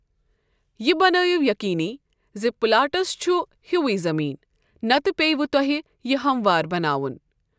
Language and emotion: Kashmiri, neutral